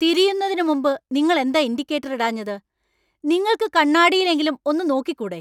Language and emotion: Malayalam, angry